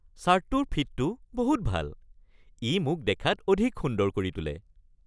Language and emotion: Assamese, happy